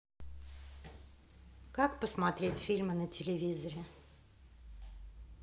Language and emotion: Russian, neutral